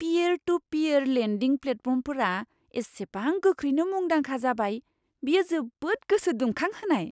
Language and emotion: Bodo, surprised